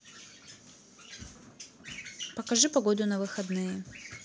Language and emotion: Russian, neutral